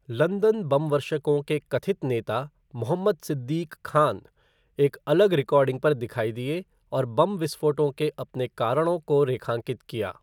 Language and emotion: Hindi, neutral